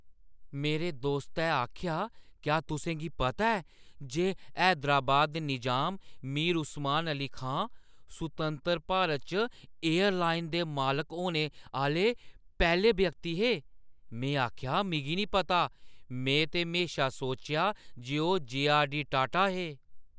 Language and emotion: Dogri, surprised